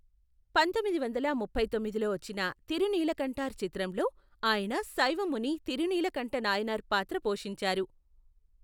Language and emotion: Telugu, neutral